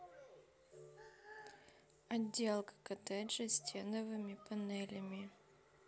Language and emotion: Russian, neutral